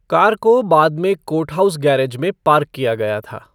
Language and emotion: Hindi, neutral